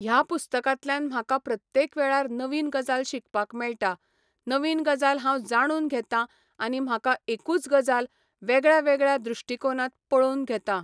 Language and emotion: Goan Konkani, neutral